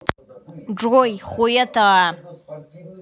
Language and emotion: Russian, angry